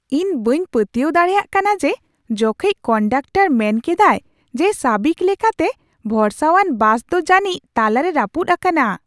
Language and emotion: Santali, surprised